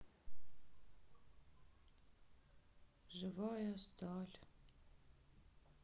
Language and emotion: Russian, sad